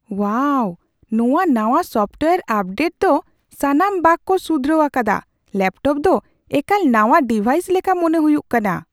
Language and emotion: Santali, surprised